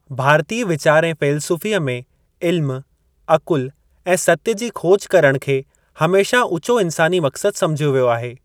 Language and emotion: Sindhi, neutral